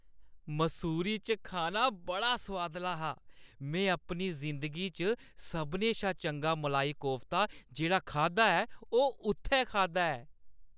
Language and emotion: Dogri, happy